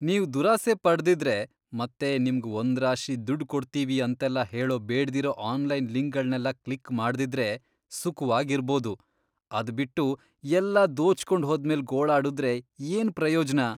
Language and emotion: Kannada, disgusted